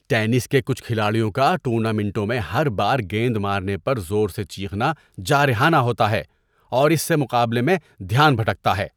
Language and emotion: Urdu, disgusted